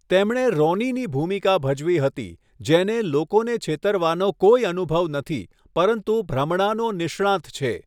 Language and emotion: Gujarati, neutral